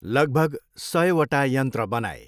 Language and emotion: Nepali, neutral